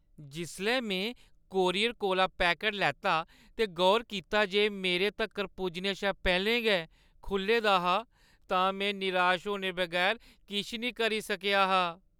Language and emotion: Dogri, sad